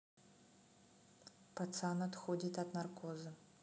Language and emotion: Russian, neutral